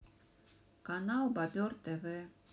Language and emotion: Russian, sad